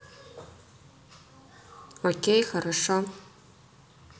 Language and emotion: Russian, neutral